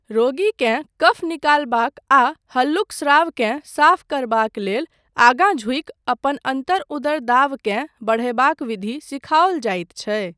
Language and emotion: Maithili, neutral